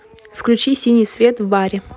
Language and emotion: Russian, neutral